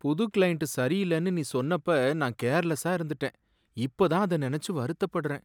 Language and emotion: Tamil, sad